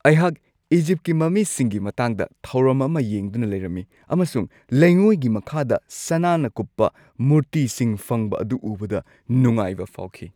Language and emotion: Manipuri, happy